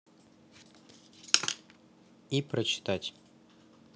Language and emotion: Russian, neutral